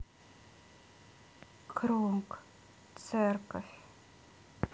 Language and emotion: Russian, neutral